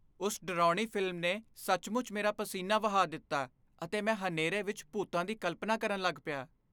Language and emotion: Punjabi, fearful